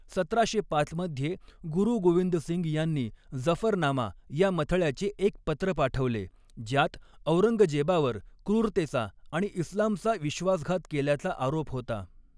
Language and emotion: Marathi, neutral